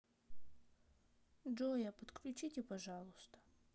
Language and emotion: Russian, sad